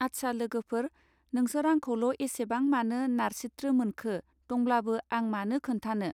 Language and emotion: Bodo, neutral